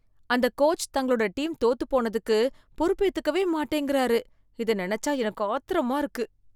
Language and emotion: Tamil, disgusted